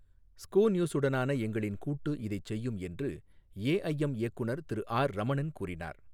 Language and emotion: Tamil, neutral